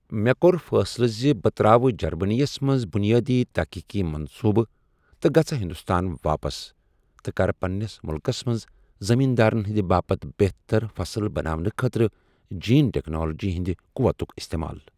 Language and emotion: Kashmiri, neutral